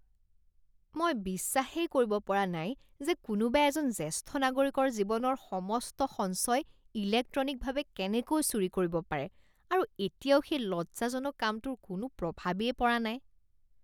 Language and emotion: Assamese, disgusted